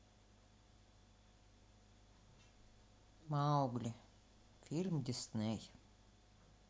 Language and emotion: Russian, sad